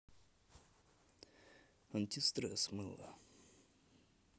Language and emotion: Russian, neutral